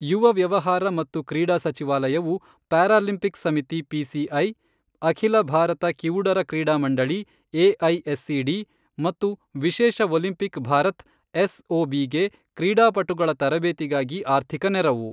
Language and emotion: Kannada, neutral